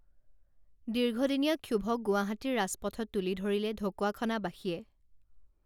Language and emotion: Assamese, neutral